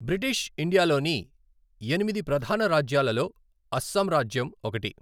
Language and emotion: Telugu, neutral